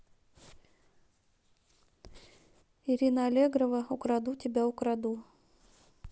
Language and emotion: Russian, neutral